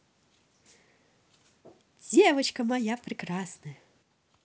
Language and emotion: Russian, positive